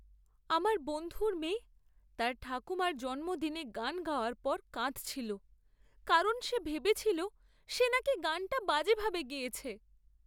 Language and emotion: Bengali, sad